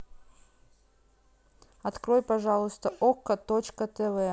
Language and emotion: Russian, neutral